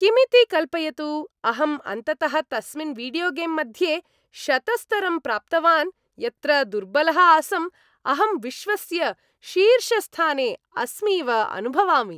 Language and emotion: Sanskrit, happy